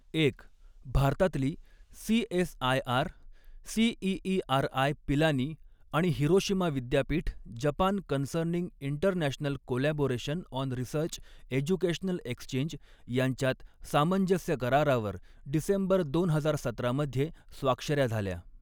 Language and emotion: Marathi, neutral